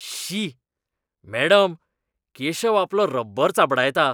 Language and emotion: Goan Konkani, disgusted